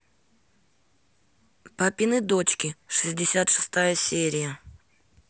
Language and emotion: Russian, neutral